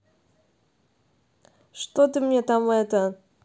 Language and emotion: Russian, angry